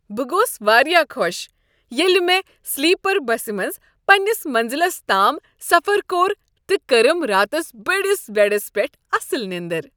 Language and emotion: Kashmiri, happy